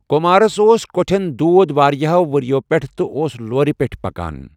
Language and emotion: Kashmiri, neutral